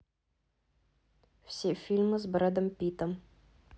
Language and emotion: Russian, neutral